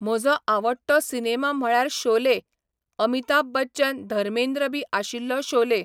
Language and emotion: Goan Konkani, neutral